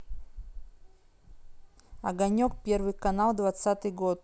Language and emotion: Russian, neutral